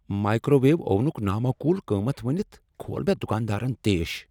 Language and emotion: Kashmiri, angry